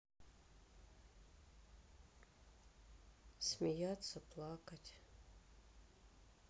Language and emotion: Russian, sad